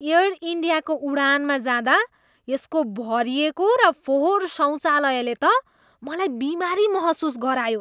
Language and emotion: Nepali, disgusted